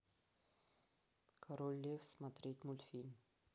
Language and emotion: Russian, neutral